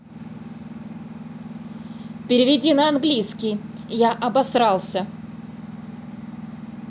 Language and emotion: Russian, angry